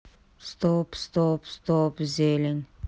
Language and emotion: Russian, neutral